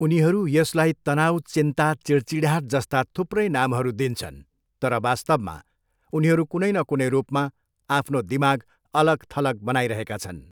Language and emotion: Nepali, neutral